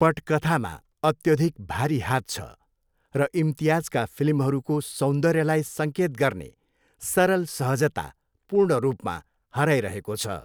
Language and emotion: Nepali, neutral